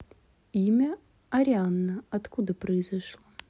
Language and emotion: Russian, neutral